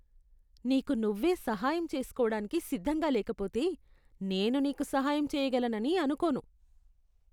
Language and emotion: Telugu, disgusted